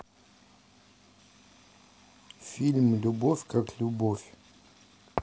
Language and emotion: Russian, neutral